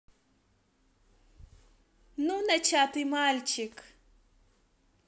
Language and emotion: Russian, positive